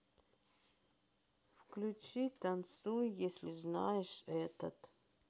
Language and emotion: Russian, sad